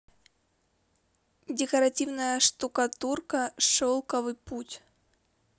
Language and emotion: Russian, neutral